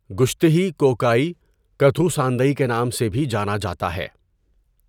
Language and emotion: Urdu, neutral